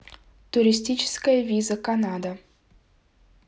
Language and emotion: Russian, neutral